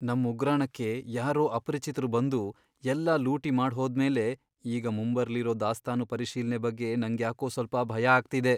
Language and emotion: Kannada, fearful